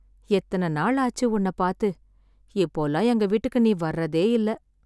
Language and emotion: Tamil, sad